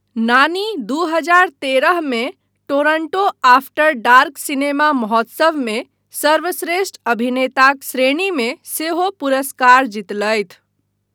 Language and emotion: Maithili, neutral